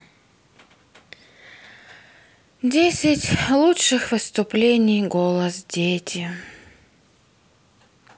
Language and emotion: Russian, sad